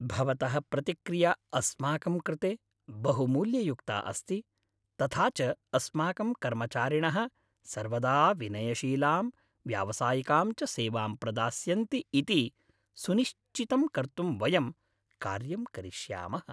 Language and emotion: Sanskrit, happy